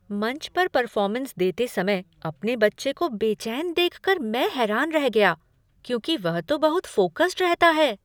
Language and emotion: Hindi, surprised